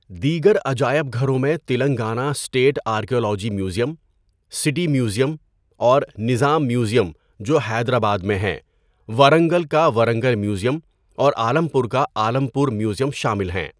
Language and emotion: Urdu, neutral